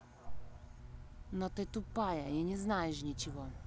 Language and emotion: Russian, angry